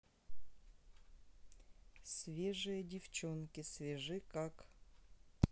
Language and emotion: Russian, neutral